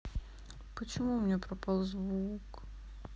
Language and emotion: Russian, sad